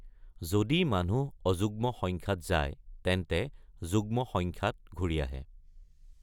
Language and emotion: Assamese, neutral